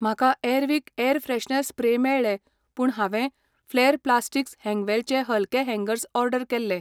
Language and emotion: Goan Konkani, neutral